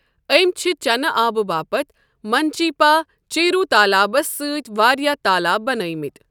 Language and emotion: Kashmiri, neutral